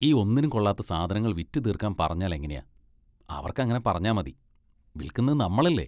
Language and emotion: Malayalam, disgusted